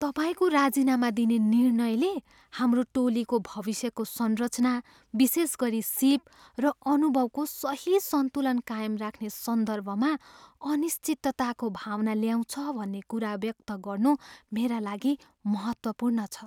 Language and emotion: Nepali, fearful